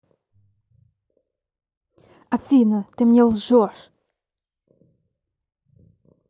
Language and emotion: Russian, angry